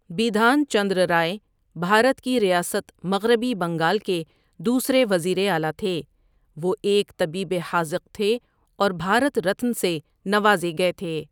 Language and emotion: Urdu, neutral